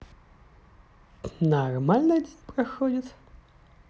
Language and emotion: Russian, positive